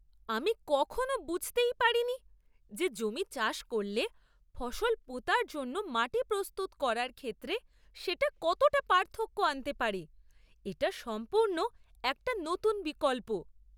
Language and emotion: Bengali, surprised